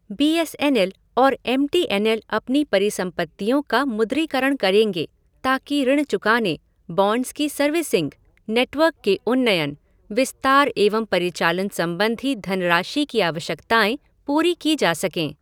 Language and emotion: Hindi, neutral